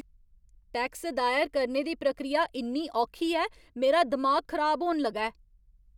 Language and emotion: Dogri, angry